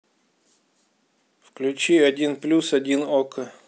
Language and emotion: Russian, neutral